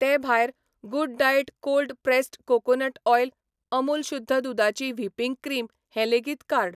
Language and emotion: Goan Konkani, neutral